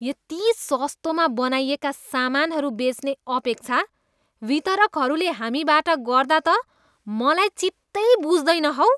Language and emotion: Nepali, disgusted